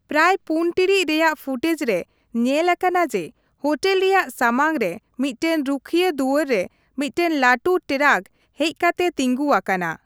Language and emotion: Santali, neutral